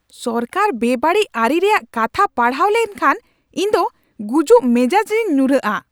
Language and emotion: Santali, angry